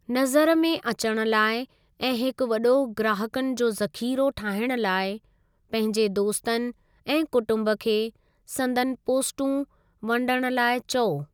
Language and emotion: Sindhi, neutral